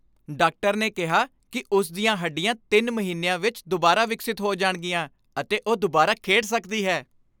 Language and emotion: Punjabi, happy